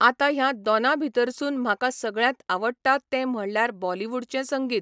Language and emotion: Goan Konkani, neutral